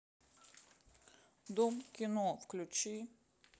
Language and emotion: Russian, sad